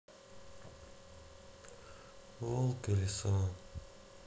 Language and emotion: Russian, sad